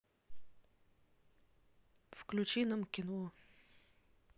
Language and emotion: Russian, neutral